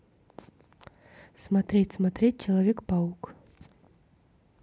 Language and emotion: Russian, neutral